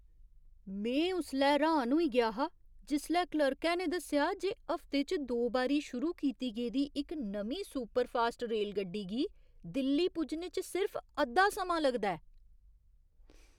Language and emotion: Dogri, surprised